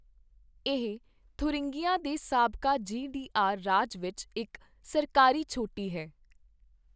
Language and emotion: Punjabi, neutral